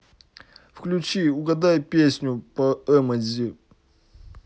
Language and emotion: Russian, neutral